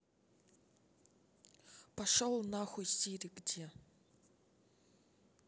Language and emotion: Russian, angry